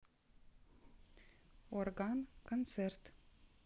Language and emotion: Russian, neutral